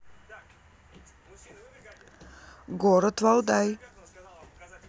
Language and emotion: Russian, neutral